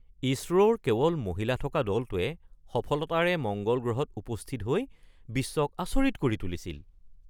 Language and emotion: Assamese, surprised